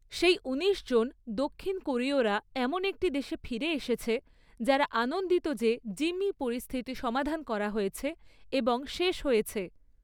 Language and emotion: Bengali, neutral